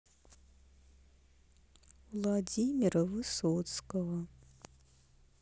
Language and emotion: Russian, sad